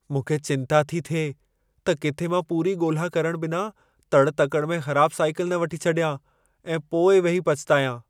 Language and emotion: Sindhi, fearful